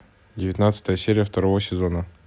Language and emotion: Russian, neutral